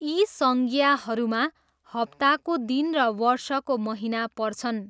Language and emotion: Nepali, neutral